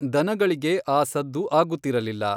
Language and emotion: Kannada, neutral